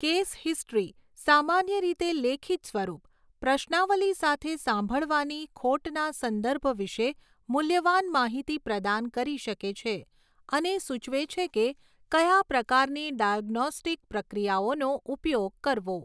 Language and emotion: Gujarati, neutral